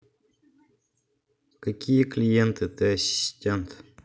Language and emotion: Russian, neutral